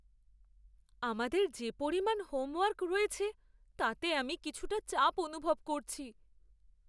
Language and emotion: Bengali, fearful